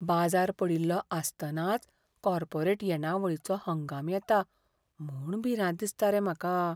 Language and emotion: Goan Konkani, fearful